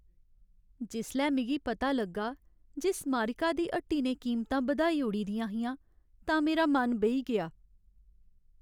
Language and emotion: Dogri, sad